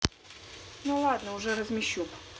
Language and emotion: Russian, neutral